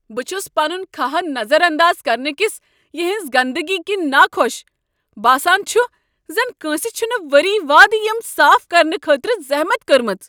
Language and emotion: Kashmiri, angry